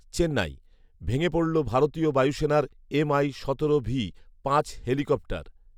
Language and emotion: Bengali, neutral